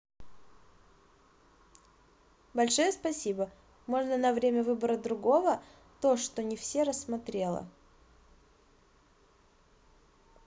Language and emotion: Russian, positive